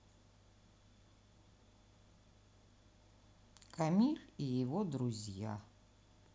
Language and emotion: Russian, neutral